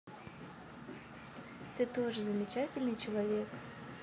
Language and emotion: Russian, neutral